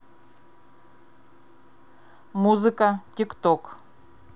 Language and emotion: Russian, neutral